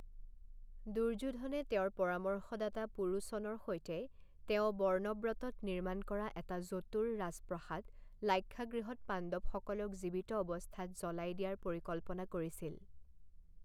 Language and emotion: Assamese, neutral